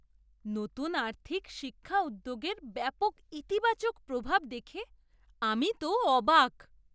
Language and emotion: Bengali, surprised